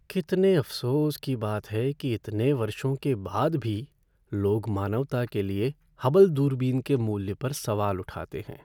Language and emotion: Hindi, sad